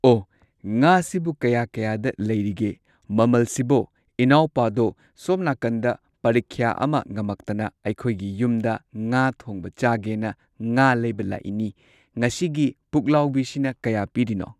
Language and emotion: Manipuri, neutral